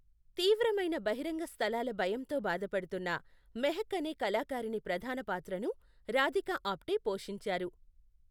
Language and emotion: Telugu, neutral